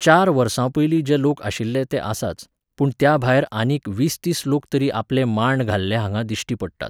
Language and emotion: Goan Konkani, neutral